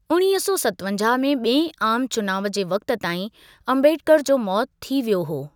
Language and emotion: Sindhi, neutral